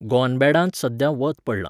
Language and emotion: Goan Konkani, neutral